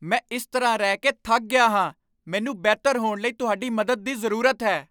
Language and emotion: Punjabi, angry